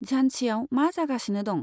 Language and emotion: Bodo, neutral